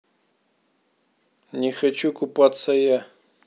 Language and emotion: Russian, neutral